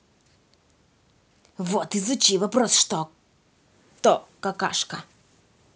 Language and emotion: Russian, angry